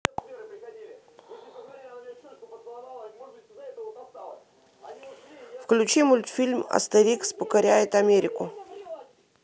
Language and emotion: Russian, neutral